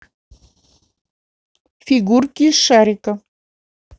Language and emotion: Russian, neutral